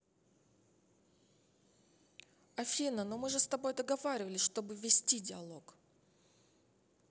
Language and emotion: Russian, angry